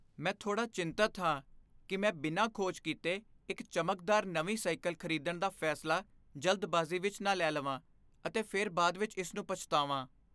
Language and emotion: Punjabi, fearful